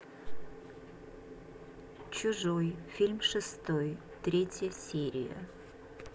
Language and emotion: Russian, neutral